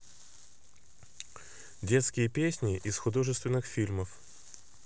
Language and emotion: Russian, neutral